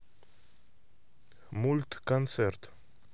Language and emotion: Russian, neutral